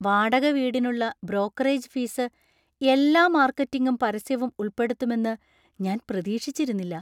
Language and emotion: Malayalam, surprised